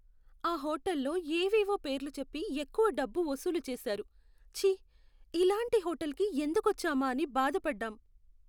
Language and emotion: Telugu, sad